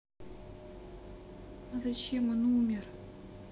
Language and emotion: Russian, sad